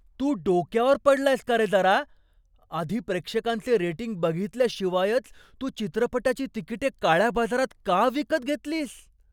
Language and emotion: Marathi, surprised